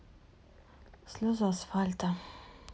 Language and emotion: Russian, sad